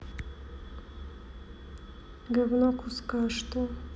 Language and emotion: Russian, sad